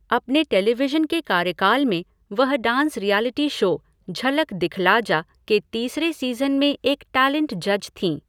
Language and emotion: Hindi, neutral